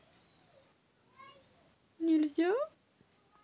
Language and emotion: Russian, neutral